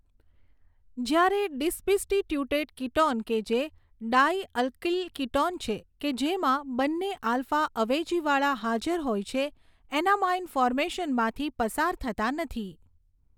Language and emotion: Gujarati, neutral